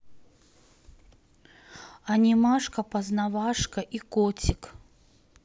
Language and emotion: Russian, neutral